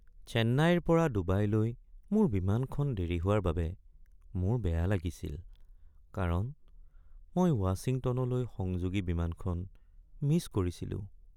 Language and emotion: Assamese, sad